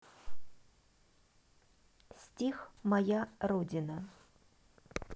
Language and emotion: Russian, neutral